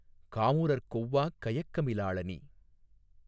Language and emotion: Tamil, neutral